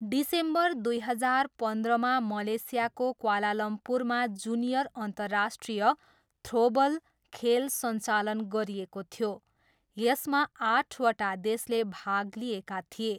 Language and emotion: Nepali, neutral